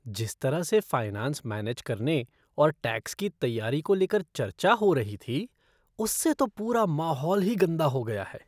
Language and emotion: Hindi, disgusted